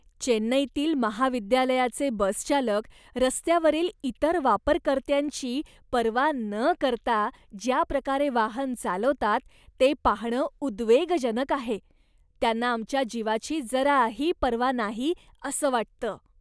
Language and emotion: Marathi, disgusted